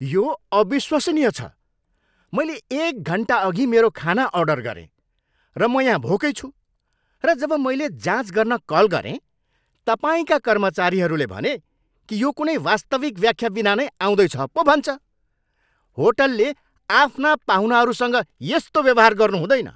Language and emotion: Nepali, angry